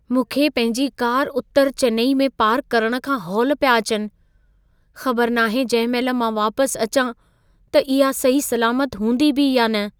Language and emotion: Sindhi, fearful